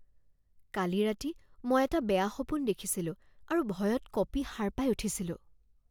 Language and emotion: Assamese, fearful